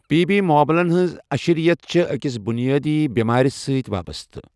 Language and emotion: Kashmiri, neutral